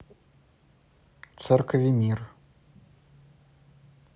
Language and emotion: Russian, neutral